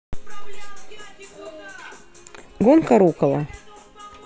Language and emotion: Russian, neutral